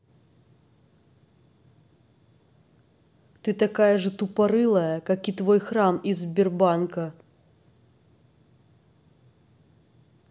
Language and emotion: Russian, angry